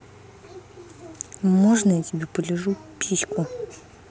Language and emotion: Russian, angry